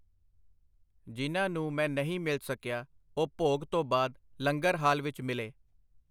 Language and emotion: Punjabi, neutral